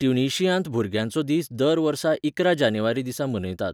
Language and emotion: Goan Konkani, neutral